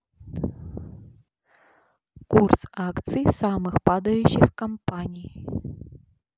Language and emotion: Russian, neutral